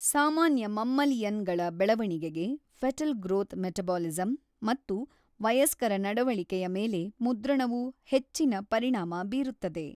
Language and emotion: Kannada, neutral